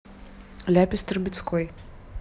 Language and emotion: Russian, neutral